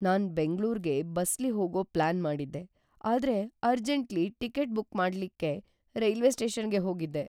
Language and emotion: Kannada, fearful